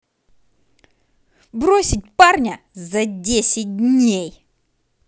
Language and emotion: Russian, angry